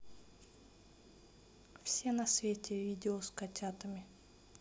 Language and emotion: Russian, neutral